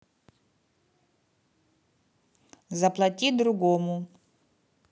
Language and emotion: Russian, neutral